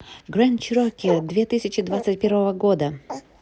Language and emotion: Russian, positive